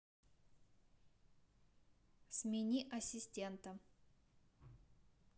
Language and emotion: Russian, neutral